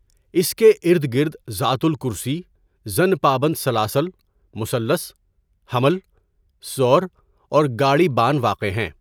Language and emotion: Urdu, neutral